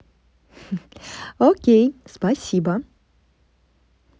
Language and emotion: Russian, positive